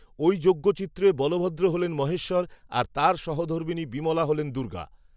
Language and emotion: Bengali, neutral